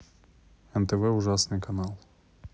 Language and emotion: Russian, neutral